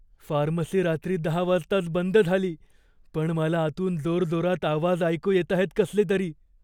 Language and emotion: Marathi, fearful